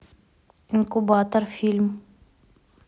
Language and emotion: Russian, neutral